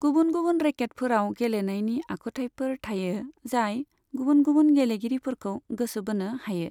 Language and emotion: Bodo, neutral